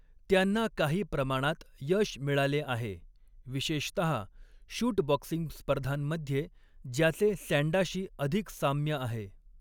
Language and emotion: Marathi, neutral